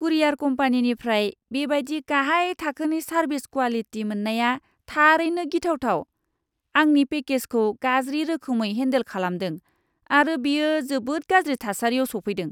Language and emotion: Bodo, disgusted